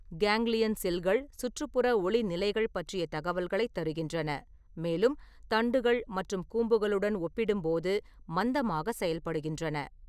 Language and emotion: Tamil, neutral